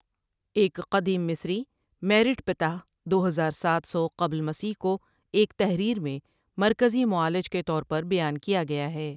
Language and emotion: Urdu, neutral